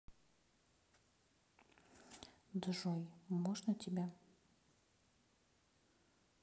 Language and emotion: Russian, neutral